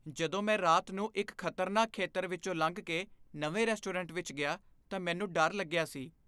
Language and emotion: Punjabi, fearful